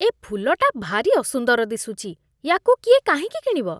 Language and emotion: Odia, disgusted